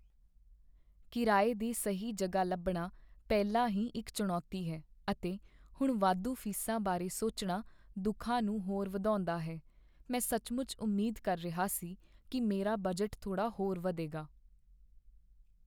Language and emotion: Punjabi, sad